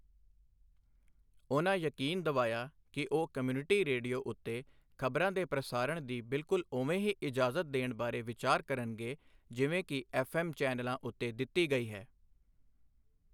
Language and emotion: Punjabi, neutral